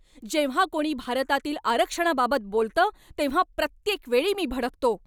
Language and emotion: Marathi, angry